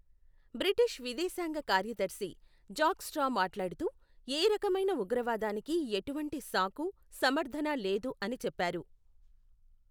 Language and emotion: Telugu, neutral